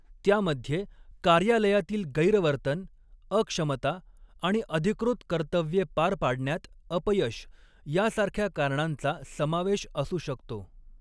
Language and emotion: Marathi, neutral